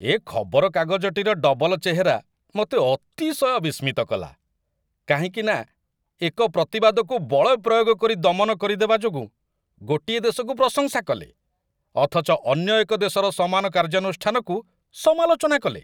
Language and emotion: Odia, disgusted